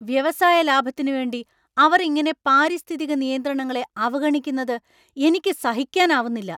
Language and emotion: Malayalam, angry